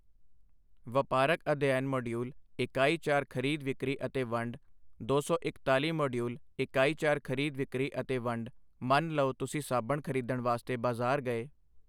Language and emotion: Punjabi, neutral